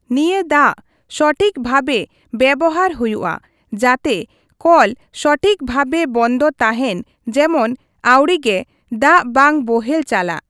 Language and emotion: Santali, neutral